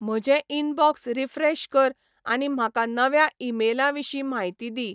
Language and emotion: Goan Konkani, neutral